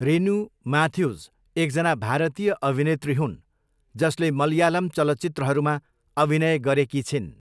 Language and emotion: Nepali, neutral